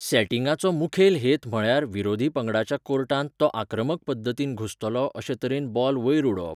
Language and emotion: Goan Konkani, neutral